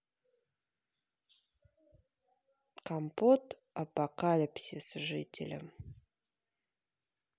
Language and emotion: Russian, neutral